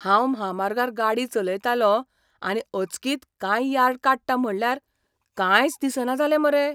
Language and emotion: Goan Konkani, surprised